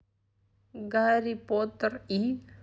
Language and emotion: Russian, neutral